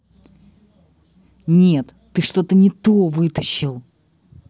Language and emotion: Russian, angry